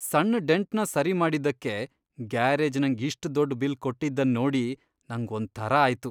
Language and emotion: Kannada, disgusted